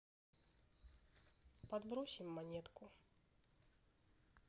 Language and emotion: Russian, sad